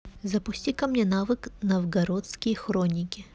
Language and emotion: Russian, neutral